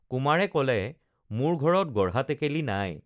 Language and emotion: Assamese, neutral